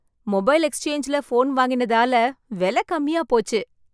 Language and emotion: Tamil, happy